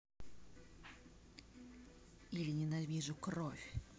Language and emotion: Russian, angry